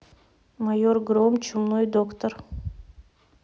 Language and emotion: Russian, neutral